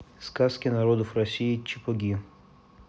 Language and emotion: Russian, neutral